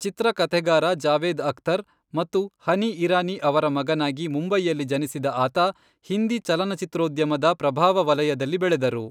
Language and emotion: Kannada, neutral